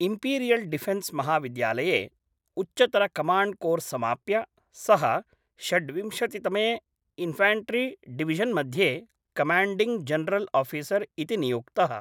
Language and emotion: Sanskrit, neutral